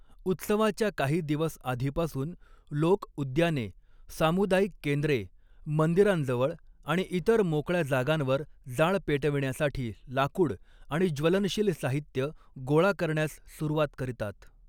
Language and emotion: Marathi, neutral